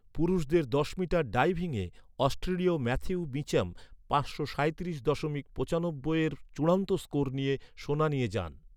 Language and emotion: Bengali, neutral